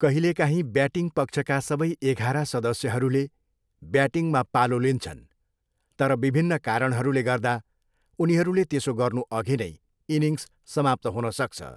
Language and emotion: Nepali, neutral